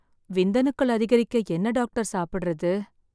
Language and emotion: Tamil, sad